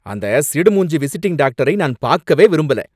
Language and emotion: Tamil, angry